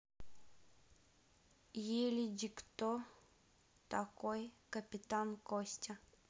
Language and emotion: Russian, neutral